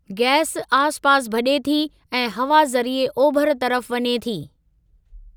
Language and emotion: Sindhi, neutral